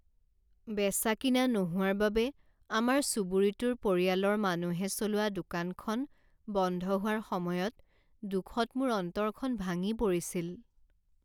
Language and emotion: Assamese, sad